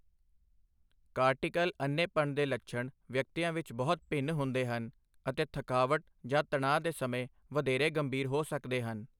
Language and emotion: Punjabi, neutral